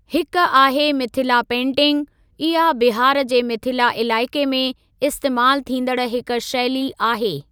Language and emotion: Sindhi, neutral